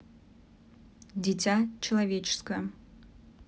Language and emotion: Russian, neutral